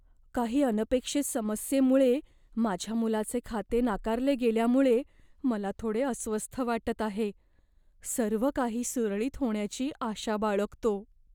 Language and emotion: Marathi, fearful